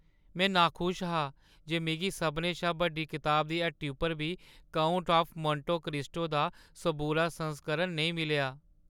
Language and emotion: Dogri, sad